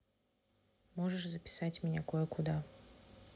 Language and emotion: Russian, neutral